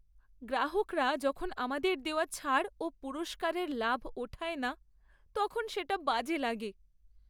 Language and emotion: Bengali, sad